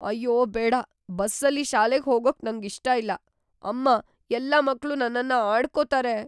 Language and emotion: Kannada, fearful